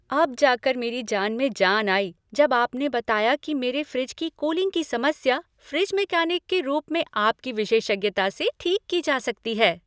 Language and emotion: Hindi, happy